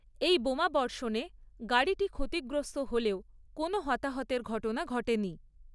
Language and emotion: Bengali, neutral